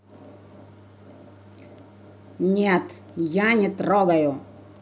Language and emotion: Russian, angry